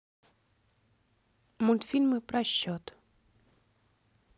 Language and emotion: Russian, neutral